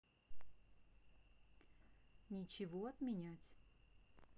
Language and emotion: Russian, neutral